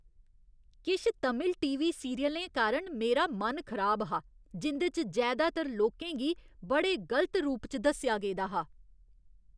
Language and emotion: Dogri, disgusted